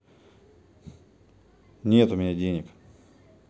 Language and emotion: Russian, neutral